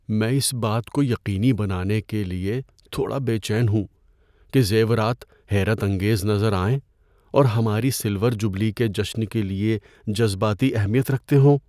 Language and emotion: Urdu, fearful